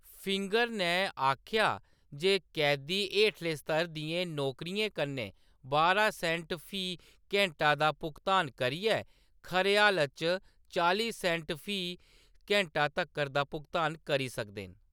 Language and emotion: Dogri, neutral